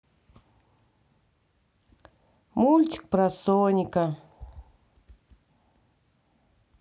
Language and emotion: Russian, sad